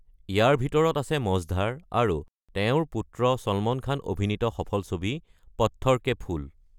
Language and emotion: Assamese, neutral